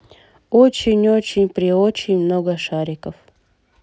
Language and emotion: Russian, neutral